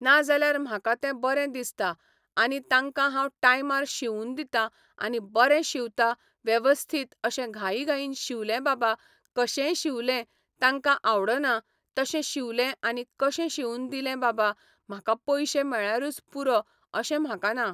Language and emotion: Goan Konkani, neutral